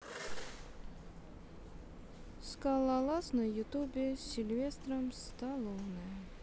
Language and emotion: Russian, sad